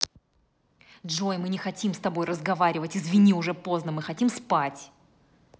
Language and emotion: Russian, angry